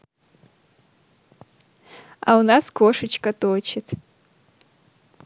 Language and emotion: Russian, positive